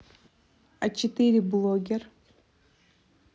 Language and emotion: Russian, neutral